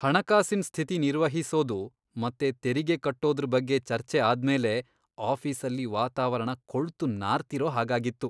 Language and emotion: Kannada, disgusted